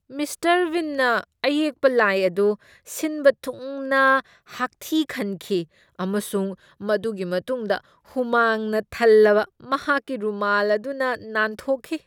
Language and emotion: Manipuri, disgusted